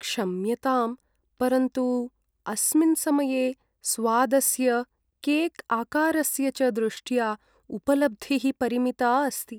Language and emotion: Sanskrit, sad